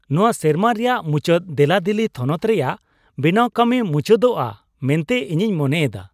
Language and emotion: Santali, happy